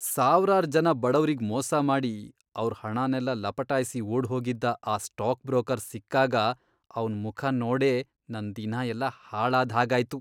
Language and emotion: Kannada, disgusted